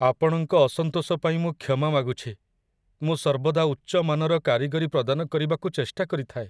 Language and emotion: Odia, sad